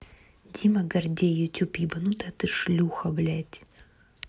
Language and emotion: Russian, angry